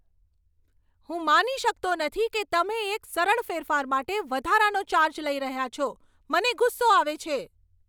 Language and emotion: Gujarati, angry